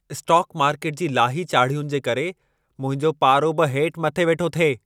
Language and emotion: Sindhi, angry